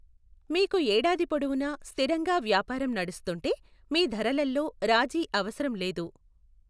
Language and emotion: Telugu, neutral